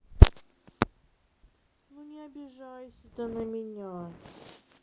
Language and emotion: Russian, sad